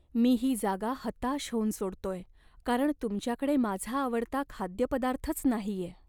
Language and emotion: Marathi, sad